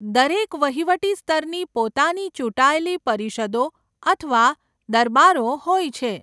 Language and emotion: Gujarati, neutral